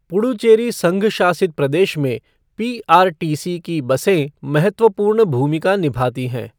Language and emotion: Hindi, neutral